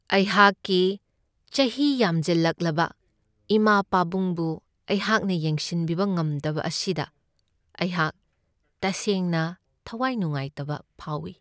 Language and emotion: Manipuri, sad